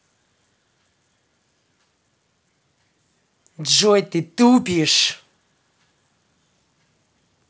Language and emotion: Russian, angry